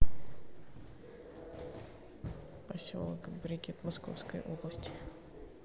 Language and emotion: Russian, neutral